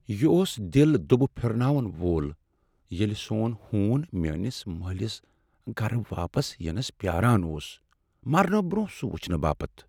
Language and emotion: Kashmiri, sad